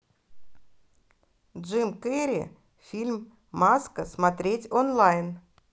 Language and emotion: Russian, positive